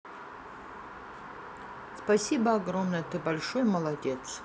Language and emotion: Russian, neutral